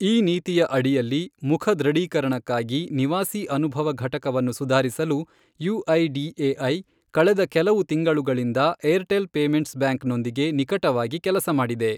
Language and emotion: Kannada, neutral